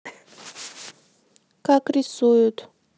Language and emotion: Russian, neutral